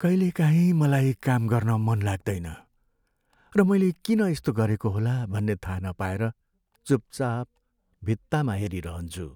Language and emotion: Nepali, sad